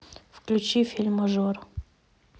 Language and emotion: Russian, neutral